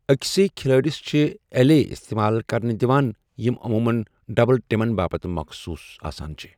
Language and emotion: Kashmiri, neutral